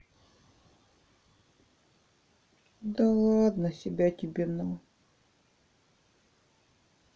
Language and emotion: Russian, sad